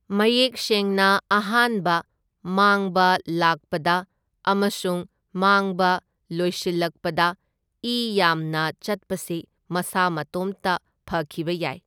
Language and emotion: Manipuri, neutral